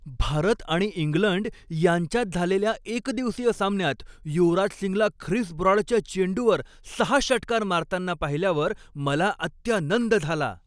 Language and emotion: Marathi, happy